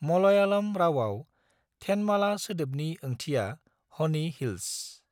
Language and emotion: Bodo, neutral